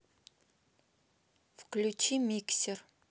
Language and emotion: Russian, neutral